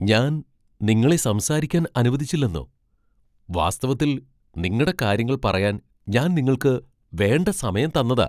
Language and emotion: Malayalam, surprised